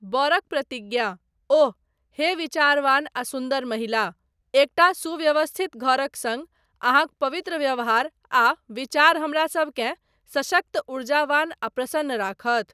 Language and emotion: Maithili, neutral